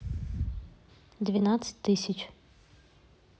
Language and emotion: Russian, neutral